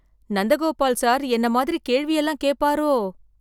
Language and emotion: Tamil, fearful